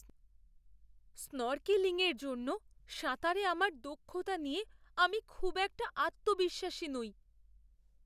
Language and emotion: Bengali, fearful